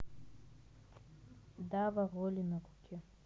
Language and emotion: Russian, neutral